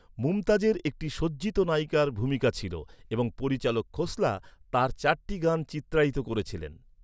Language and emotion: Bengali, neutral